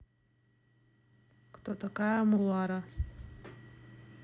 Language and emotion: Russian, neutral